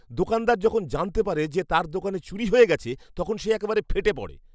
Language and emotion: Bengali, angry